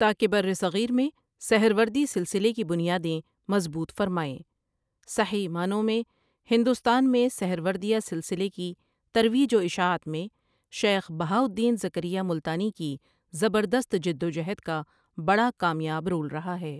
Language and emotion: Urdu, neutral